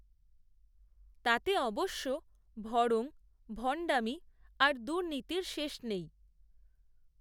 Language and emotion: Bengali, neutral